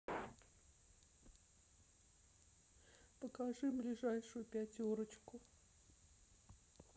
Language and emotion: Russian, sad